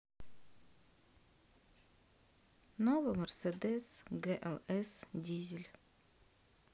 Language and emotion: Russian, neutral